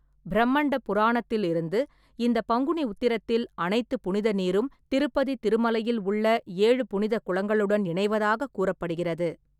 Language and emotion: Tamil, neutral